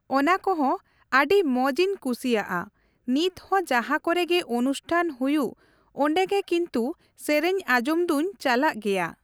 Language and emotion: Santali, neutral